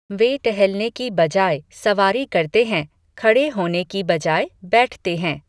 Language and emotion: Hindi, neutral